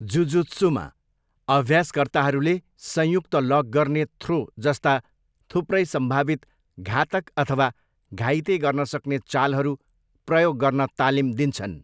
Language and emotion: Nepali, neutral